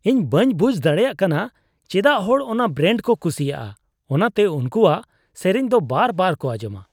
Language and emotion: Santali, disgusted